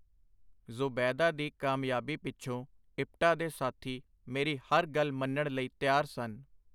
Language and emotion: Punjabi, neutral